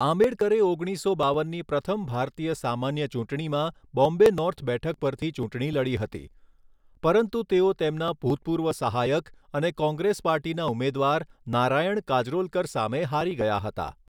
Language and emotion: Gujarati, neutral